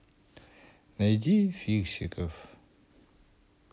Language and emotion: Russian, sad